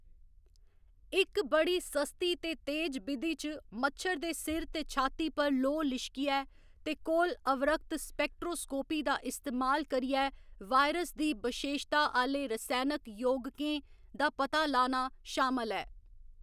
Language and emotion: Dogri, neutral